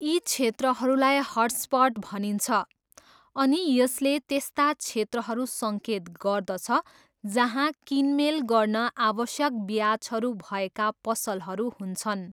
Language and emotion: Nepali, neutral